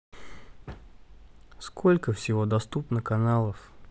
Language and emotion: Russian, neutral